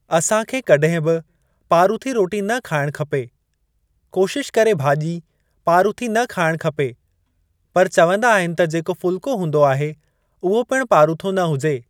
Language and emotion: Sindhi, neutral